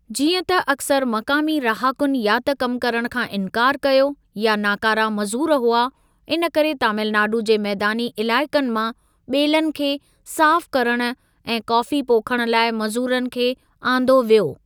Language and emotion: Sindhi, neutral